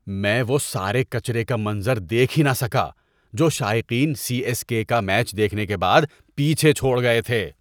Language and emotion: Urdu, disgusted